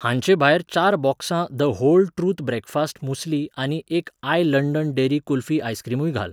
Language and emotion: Goan Konkani, neutral